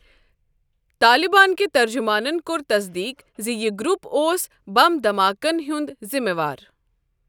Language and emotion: Kashmiri, neutral